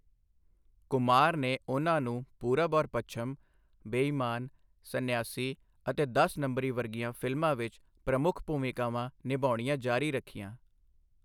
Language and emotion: Punjabi, neutral